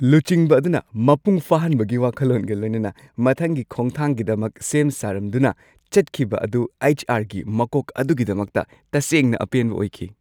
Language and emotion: Manipuri, happy